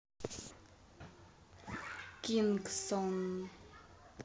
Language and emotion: Russian, neutral